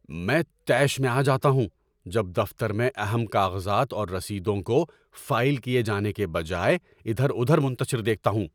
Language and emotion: Urdu, angry